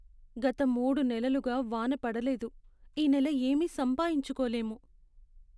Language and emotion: Telugu, sad